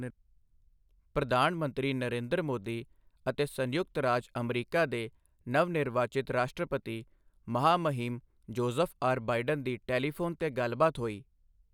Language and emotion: Punjabi, neutral